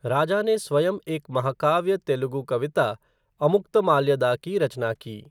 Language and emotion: Hindi, neutral